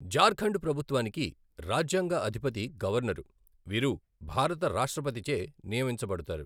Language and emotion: Telugu, neutral